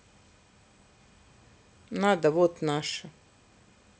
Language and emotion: Russian, neutral